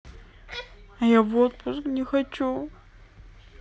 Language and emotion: Russian, sad